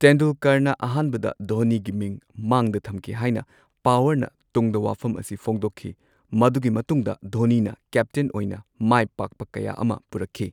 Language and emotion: Manipuri, neutral